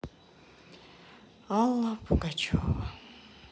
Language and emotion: Russian, sad